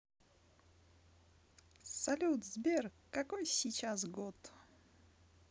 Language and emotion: Russian, positive